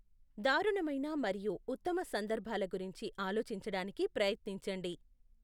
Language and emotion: Telugu, neutral